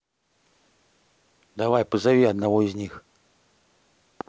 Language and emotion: Russian, neutral